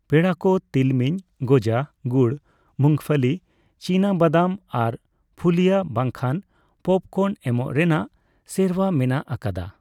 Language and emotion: Santali, neutral